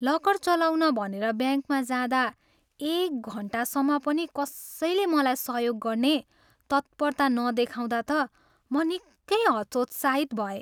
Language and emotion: Nepali, sad